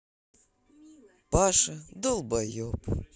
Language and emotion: Russian, sad